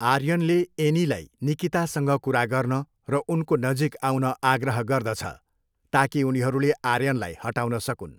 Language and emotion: Nepali, neutral